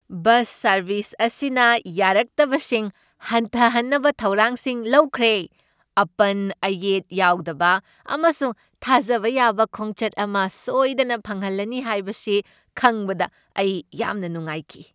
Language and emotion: Manipuri, happy